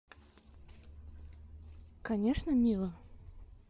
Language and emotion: Russian, neutral